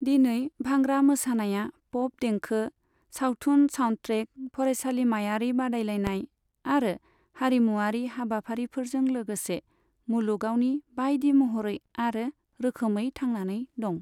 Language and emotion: Bodo, neutral